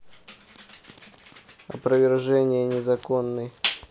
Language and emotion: Russian, neutral